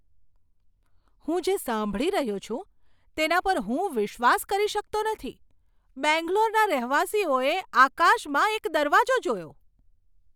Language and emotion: Gujarati, surprised